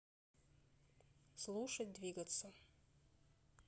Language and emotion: Russian, neutral